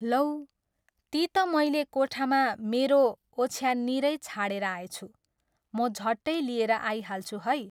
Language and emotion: Nepali, neutral